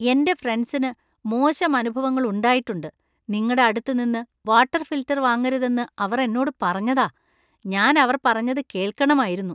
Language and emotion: Malayalam, disgusted